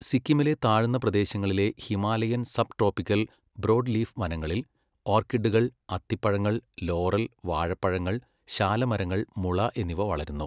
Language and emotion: Malayalam, neutral